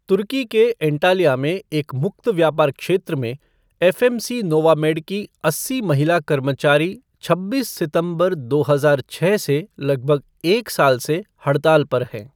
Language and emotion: Hindi, neutral